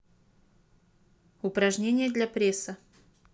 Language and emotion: Russian, neutral